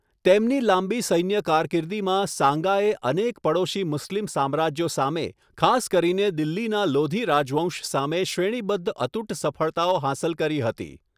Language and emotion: Gujarati, neutral